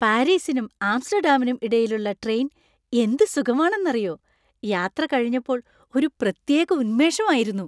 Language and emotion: Malayalam, happy